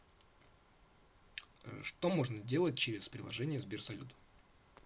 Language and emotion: Russian, neutral